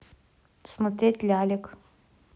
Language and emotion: Russian, neutral